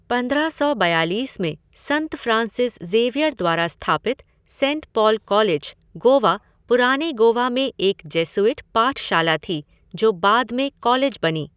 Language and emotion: Hindi, neutral